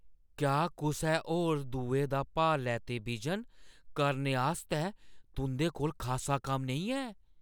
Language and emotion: Dogri, surprised